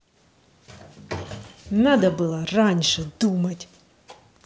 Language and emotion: Russian, angry